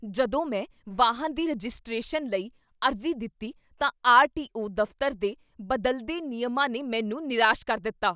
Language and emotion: Punjabi, angry